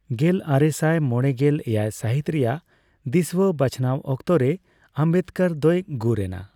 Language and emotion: Santali, neutral